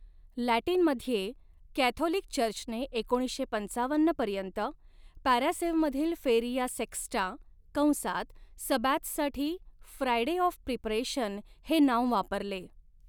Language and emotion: Marathi, neutral